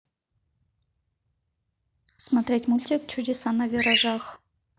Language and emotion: Russian, neutral